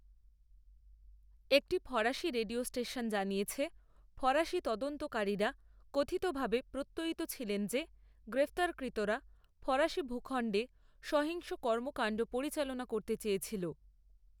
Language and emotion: Bengali, neutral